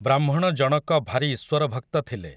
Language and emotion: Odia, neutral